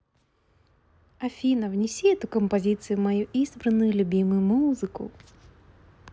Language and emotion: Russian, positive